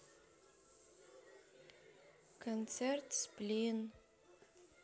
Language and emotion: Russian, sad